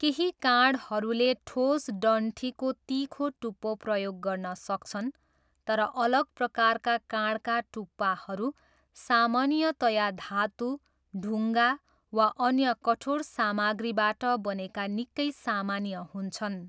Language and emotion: Nepali, neutral